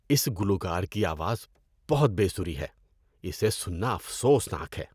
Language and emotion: Urdu, disgusted